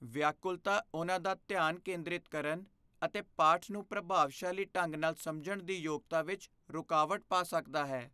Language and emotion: Punjabi, fearful